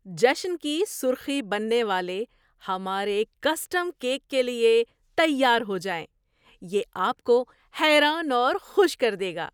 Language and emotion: Urdu, surprised